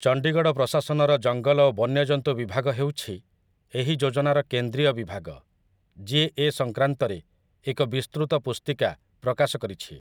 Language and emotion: Odia, neutral